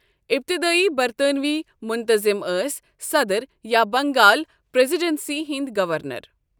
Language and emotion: Kashmiri, neutral